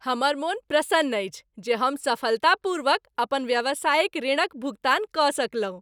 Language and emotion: Maithili, happy